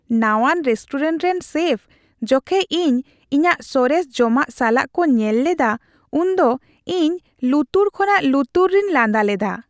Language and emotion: Santali, happy